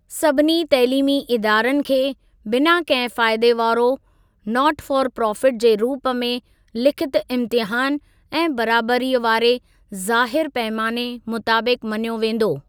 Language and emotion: Sindhi, neutral